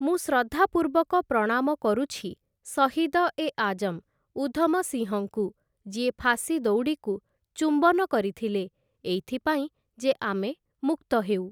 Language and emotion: Odia, neutral